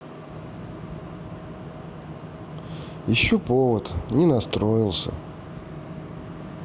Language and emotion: Russian, sad